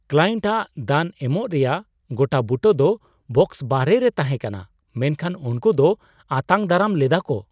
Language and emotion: Santali, surprised